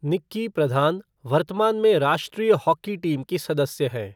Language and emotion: Hindi, neutral